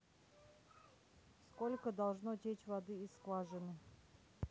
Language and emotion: Russian, neutral